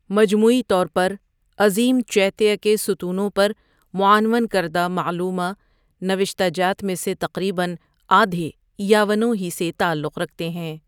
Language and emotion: Urdu, neutral